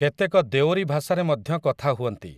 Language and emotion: Odia, neutral